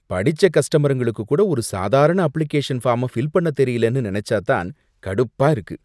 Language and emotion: Tamil, disgusted